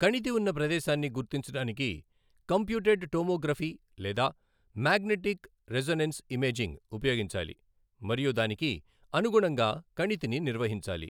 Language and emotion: Telugu, neutral